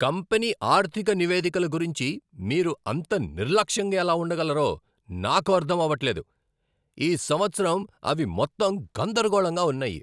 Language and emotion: Telugu, angry